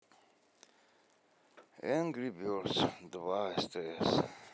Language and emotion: Russian, sad